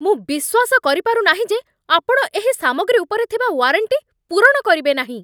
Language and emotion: Odia, angry